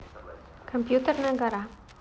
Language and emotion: Russian, neutral